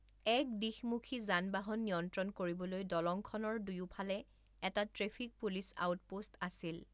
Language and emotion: Assamese, neutral